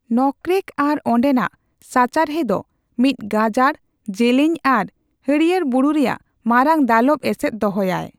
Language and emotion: Santali, neutral